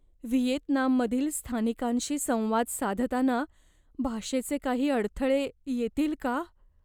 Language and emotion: Marathi, fearful